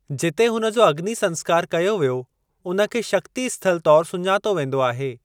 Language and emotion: Sindhi, neutral